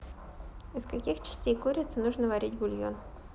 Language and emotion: Russian, neutral